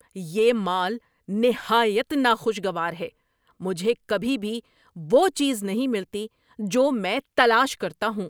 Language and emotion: Urdu, angry